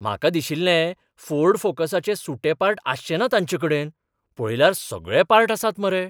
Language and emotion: Goan Konkani, surprised